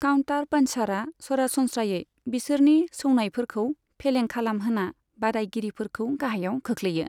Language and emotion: Bodo, neutral